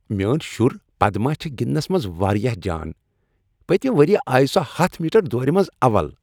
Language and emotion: Kashmiri, happy